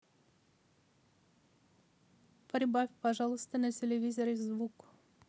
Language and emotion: Russian, neutral